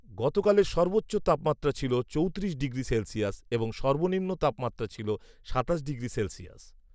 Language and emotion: Bengali, neutral